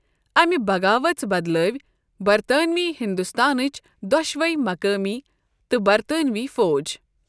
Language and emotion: Kashmiri, neutral